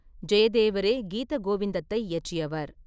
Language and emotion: Tamil, neutral